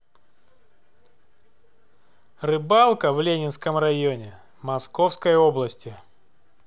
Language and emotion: Russian, neutral